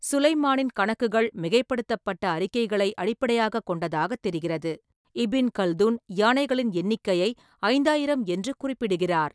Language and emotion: Tamil, neutral